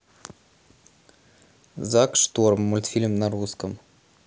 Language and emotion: Russian, neutral